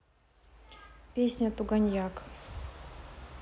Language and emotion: Russian, neutral